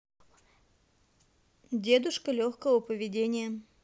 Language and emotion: Russian, neutral